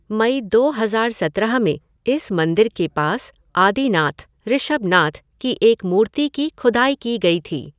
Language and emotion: Hindi, neutral